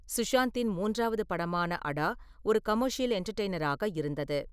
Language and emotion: Tamil, neutral